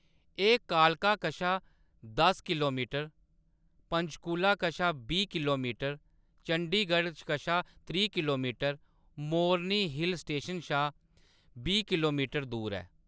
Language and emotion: Dogri, neutral